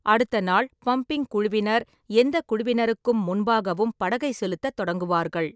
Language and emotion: Tamil, neutral